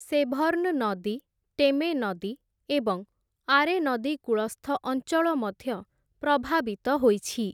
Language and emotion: Odia, neutral